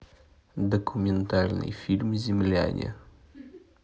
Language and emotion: Russian, neutral